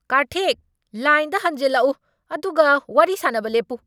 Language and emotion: Manipuri, angry